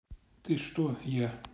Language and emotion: Russian, neutral